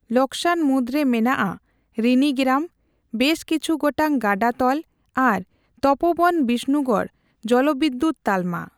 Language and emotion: Santali, neutral